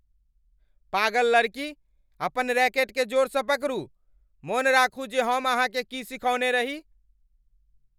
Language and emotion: Maithili, angry